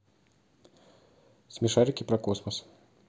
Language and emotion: Russian, neutral